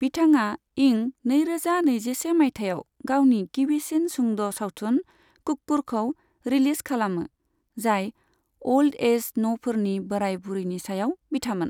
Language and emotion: Bodo, neutral